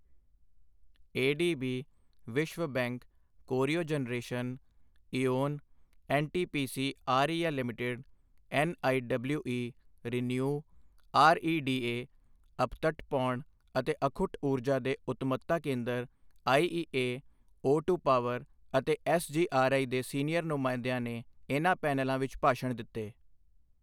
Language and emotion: Punjabi, neutral